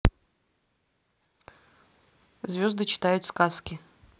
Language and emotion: Russian, neutral